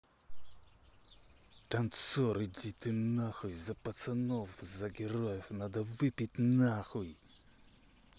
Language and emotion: Russian, angry